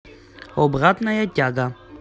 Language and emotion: Russian, positive